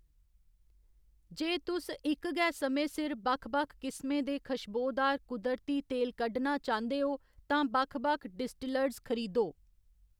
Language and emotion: Dogri, neutral